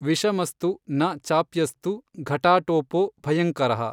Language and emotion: Kannada, neutral